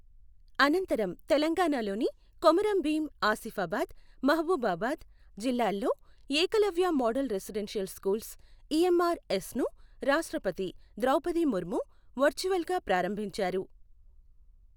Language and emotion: Telugu, neutral